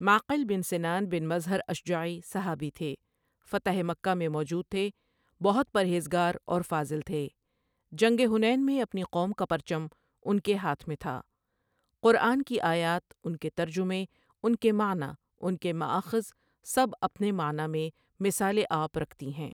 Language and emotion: Urdu, neutral